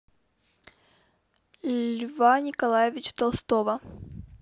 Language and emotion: Russian, neutral